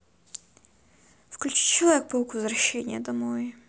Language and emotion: Russian, neutral